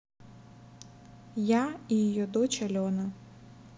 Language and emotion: Russian, neutral